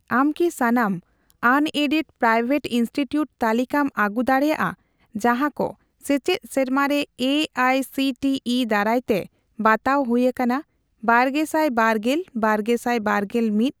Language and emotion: Santali, neutral